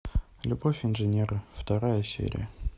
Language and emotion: Russian, neutral